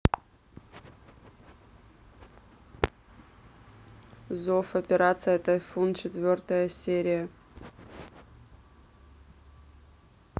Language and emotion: Russian, neutral